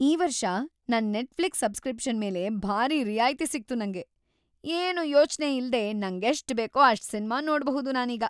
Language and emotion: Kannada, happy